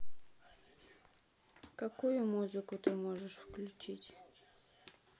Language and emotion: Russian, sad